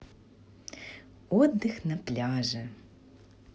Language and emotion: Russian, neutral